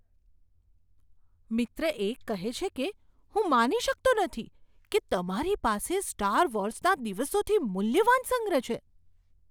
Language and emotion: Gujarati, surprised